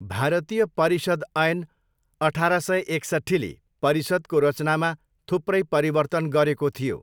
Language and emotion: Nepali, neutral